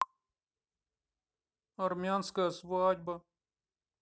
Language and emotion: Russian, sad